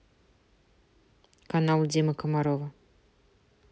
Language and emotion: Russian, neutral